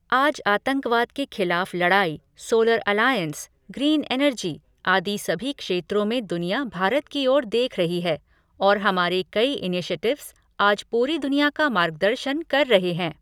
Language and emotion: Hindi, neutral